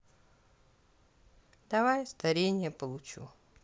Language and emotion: Russian, neutral